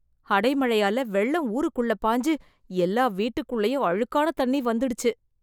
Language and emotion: Tamil, disgusted